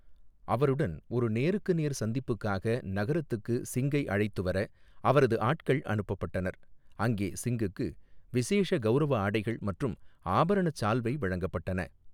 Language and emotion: Tamil, neutral